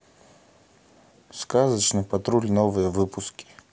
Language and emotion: Russian, neutral